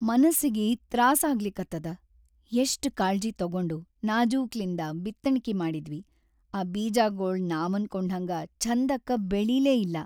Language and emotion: Kannada, sad